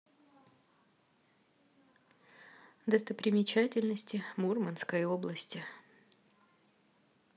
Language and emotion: Russian, neutral